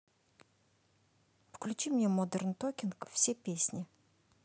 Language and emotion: Russian, neutral